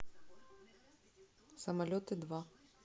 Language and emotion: Russian, neutral